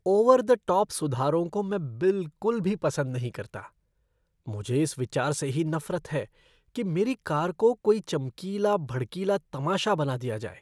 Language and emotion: Hindi, disgusted